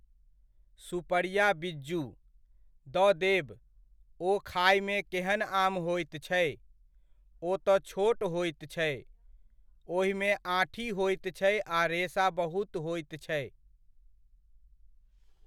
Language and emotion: Maithili, neutral